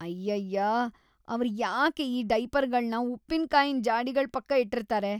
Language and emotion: Kannada, disgusted